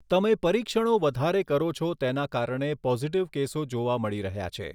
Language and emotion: Gujarati, neutral